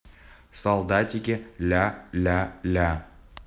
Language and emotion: Russian, neutral